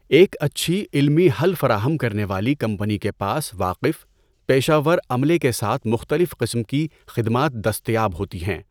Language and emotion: Urdu, neutral